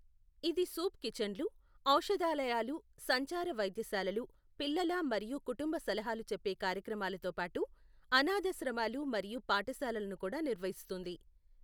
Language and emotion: Telugu, neutral